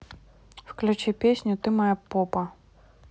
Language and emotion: Russian, neutral